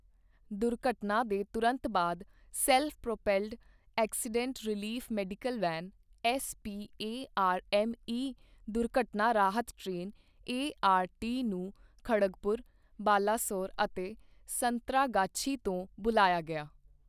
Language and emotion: Punjabi, neutral